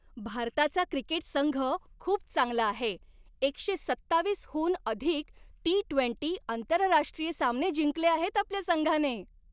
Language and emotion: Marathi, happy